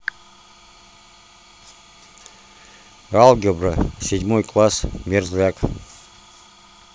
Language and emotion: Russian, neutral